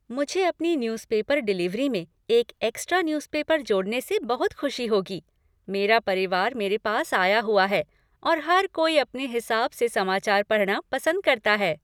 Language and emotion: Hindi, happy